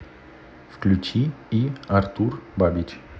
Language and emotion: Russian, neutral